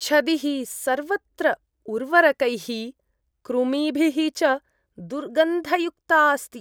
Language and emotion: Sanskrit, disgusted